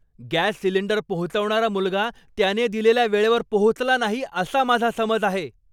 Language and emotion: Marathi, angry